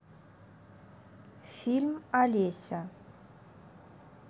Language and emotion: Russian, neutral